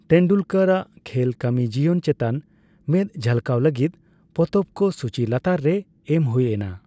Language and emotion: Santali, neutral